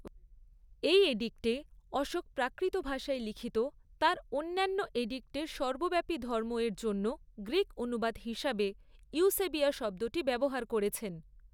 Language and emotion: Bengali, neutral